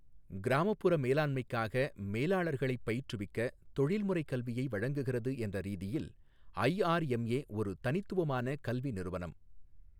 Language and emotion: Tamil, neutral